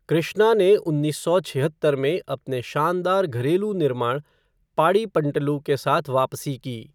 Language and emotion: Hindi, neutral